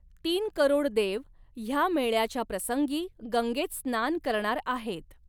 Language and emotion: Marathi, neutral